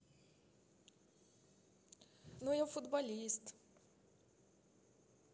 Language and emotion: Russian, neutral